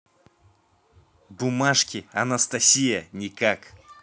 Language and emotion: Russian, neutral